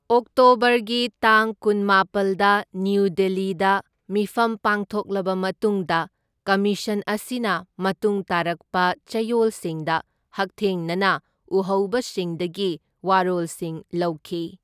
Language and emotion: Manipuri, neutral